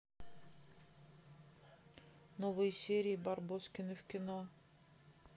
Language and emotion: Russian, neutral